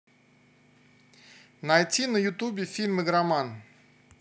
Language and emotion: Russian, positive